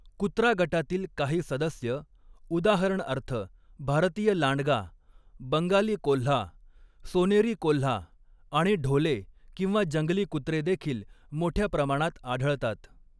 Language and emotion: Marathi, neutral